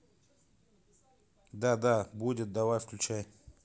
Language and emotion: Russian, neutral